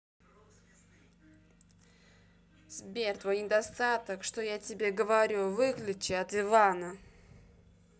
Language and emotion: Russian, angry